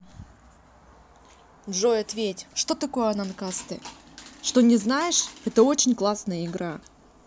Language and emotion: Russian, neutral